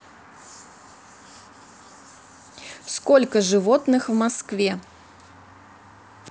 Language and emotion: Russian, neutral